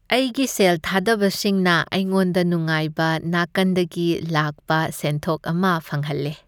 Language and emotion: Manipuri, happy